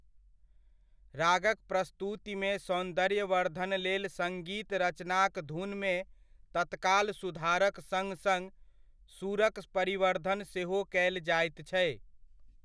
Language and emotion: Maithili, neutral